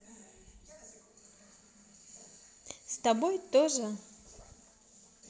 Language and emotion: Russian, positive